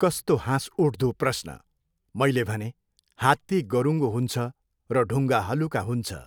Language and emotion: Nepali, neutral